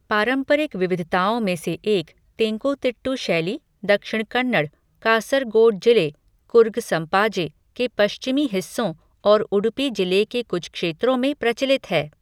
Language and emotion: Hindi, neutral